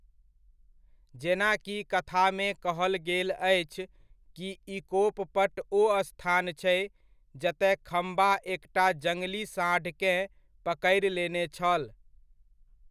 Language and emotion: Maithili, neutral